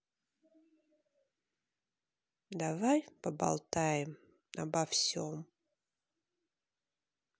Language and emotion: Russian, sad